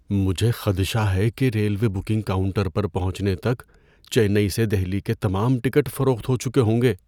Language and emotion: Urdu, fearful